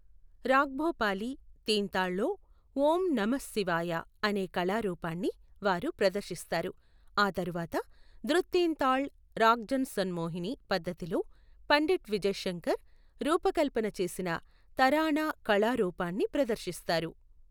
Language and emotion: Telugu, neutral